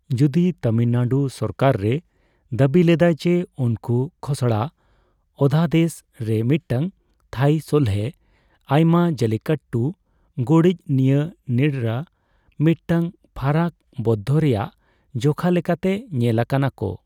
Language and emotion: Santali, neutral